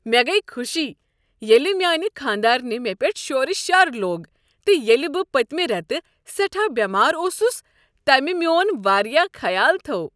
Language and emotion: Kashmiri, happy